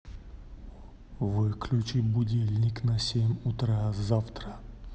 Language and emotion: Russian, neutral